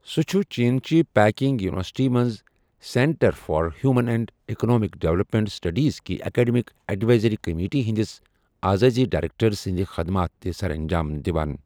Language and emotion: Kashmiri, neutral